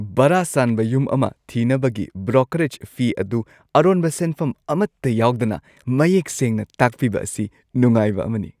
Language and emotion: Manipuri, happy